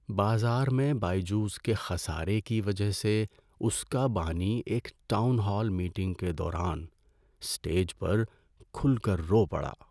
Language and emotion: Urdu, sad